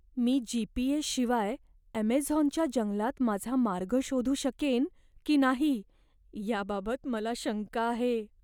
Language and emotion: Marathi, fearful